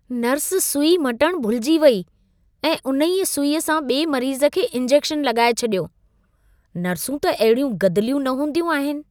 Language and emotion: Sindhi, disgusted